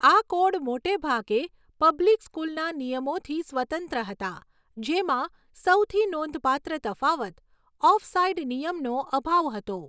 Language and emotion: Gujarati, neutral